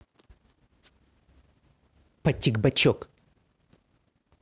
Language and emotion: Russian, angry